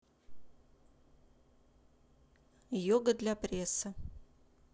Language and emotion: Russian, neutral